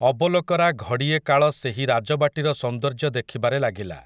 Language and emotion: Odia, neutral